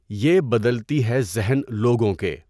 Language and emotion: Urdu, neutral